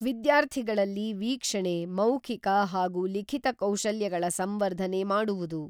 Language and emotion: Kannada, neutral